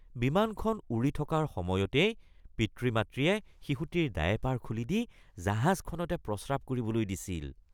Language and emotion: Assamese, disgusted